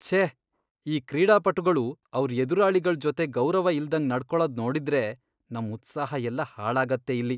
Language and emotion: Kannada, disgusted